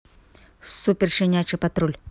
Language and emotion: Russian, neutral